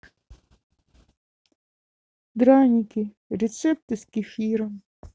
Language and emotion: Russian, sad